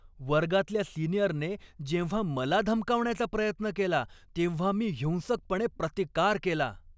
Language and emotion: Marathi, angry